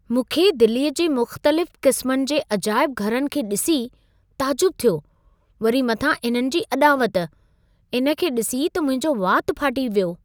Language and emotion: Sindhi, surprised